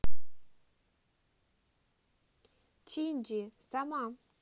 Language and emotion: Russian, neutral